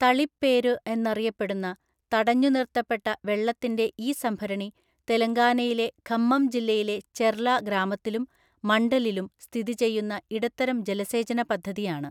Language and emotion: Malayalam, neutral